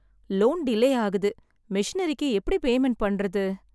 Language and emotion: Tamil, sad